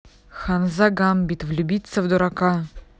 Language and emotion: Russian, angry